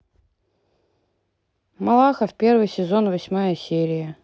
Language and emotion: Russian, neutral